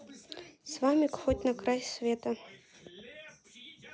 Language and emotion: Russian, neutral